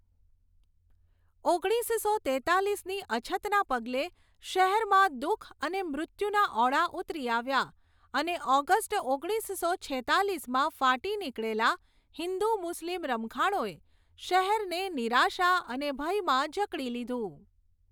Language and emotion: Gujarati, neutral